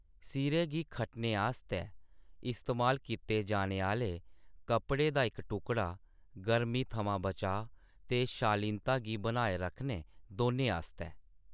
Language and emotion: Dogri, neutral